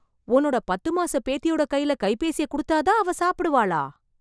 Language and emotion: Tamil, surprised